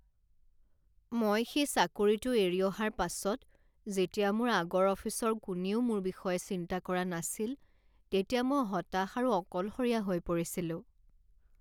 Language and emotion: Assamese, sad